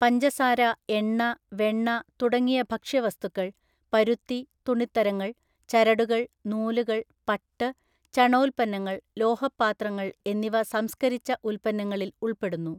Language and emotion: Malayalam, neutral